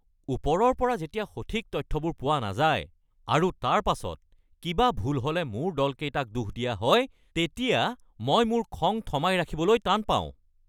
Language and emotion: Assamese, angry